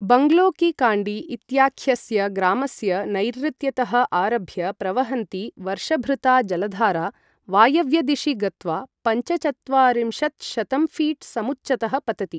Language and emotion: Sanskrit, neutral